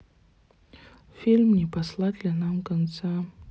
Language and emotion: Russian, sad